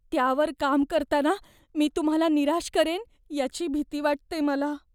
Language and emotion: Marathi, fearful